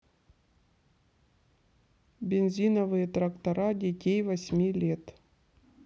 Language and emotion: Russian, neutral